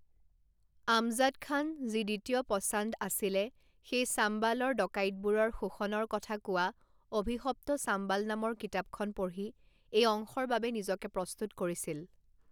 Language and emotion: Assamese, neutral